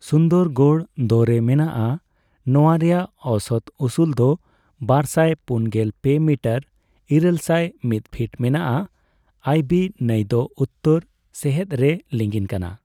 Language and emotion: Santali, neutral